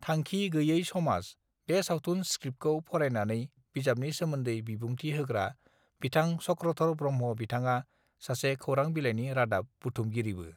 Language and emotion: Bodo, neutral